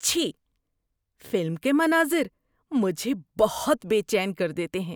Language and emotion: Urdu, disgusted